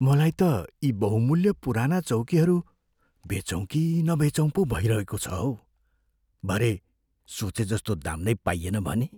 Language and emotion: Nepali, fearful